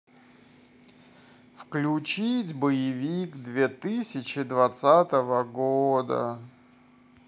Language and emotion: Russian, sad